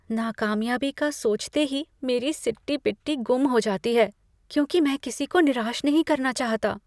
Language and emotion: Hindi, fearful